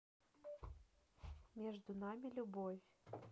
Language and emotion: Russian, neutral